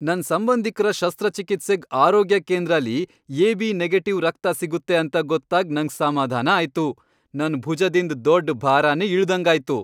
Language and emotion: Kannada, happy